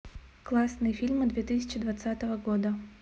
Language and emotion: Russian, neutral